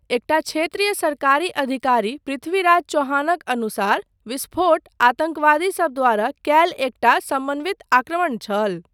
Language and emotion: Maithili, neutral